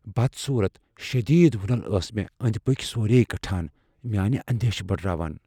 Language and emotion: Kashmiri, fearful